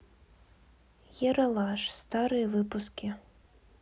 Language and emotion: Russian, neutral